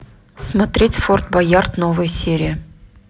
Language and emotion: Russian, neutral